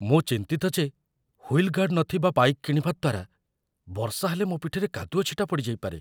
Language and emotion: Odia, fearful